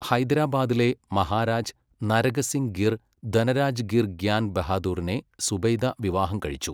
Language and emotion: Malayalam, neutral